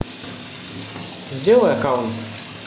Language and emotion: Russian, neutral